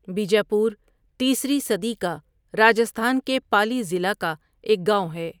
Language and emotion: Urdu, neutral